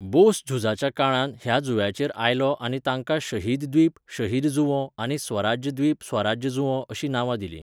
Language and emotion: Goan Konkani, neutral